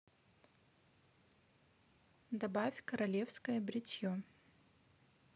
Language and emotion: Russian, neutral